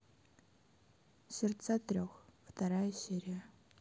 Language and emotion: Russian, neutral